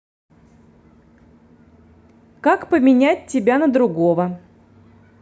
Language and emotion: Russian, neutral